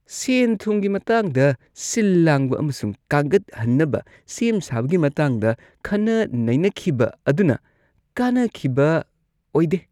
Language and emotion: Manipuri, disgusted